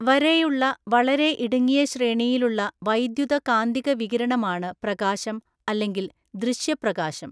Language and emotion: Malayalam, neutral